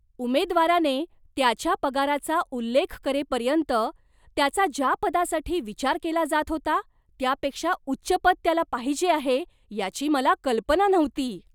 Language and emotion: Marathi, surprised